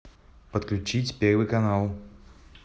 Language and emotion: Russian, neutral